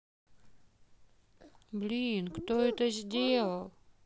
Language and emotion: Russian, neutral